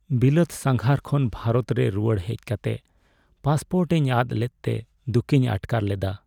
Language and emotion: Santali, sad